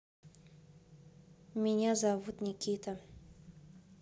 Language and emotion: Russian, neutral